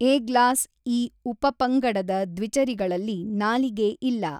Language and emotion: Kannada, neutral